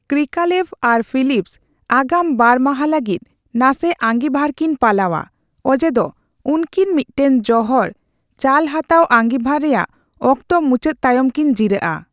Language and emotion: Santali, neutral